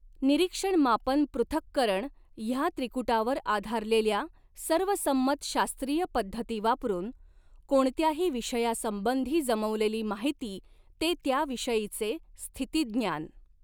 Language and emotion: Marathi, neutral